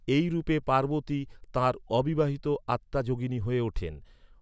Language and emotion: Bengali, neutral